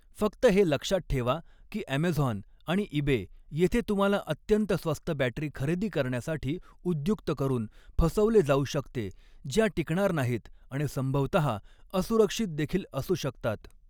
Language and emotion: Marathi, neutral